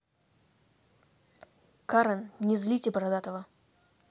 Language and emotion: Russian, angry